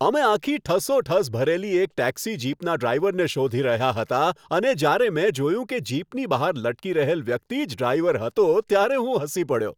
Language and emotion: Gujarati, happy